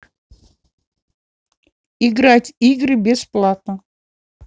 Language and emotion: Russian, neutral